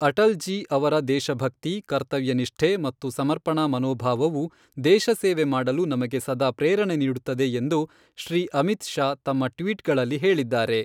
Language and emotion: Kannada, neutral